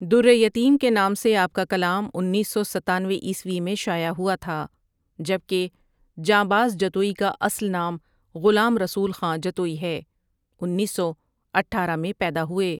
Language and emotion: Urdu, neutral